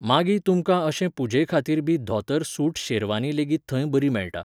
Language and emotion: Goan Konkani, neutral